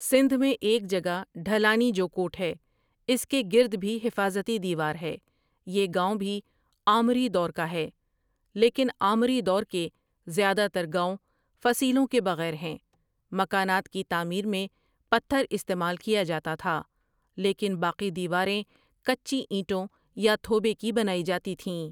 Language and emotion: Urdu, neutral